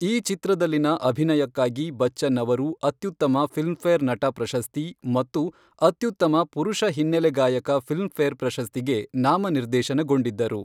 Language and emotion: Kannada, neutral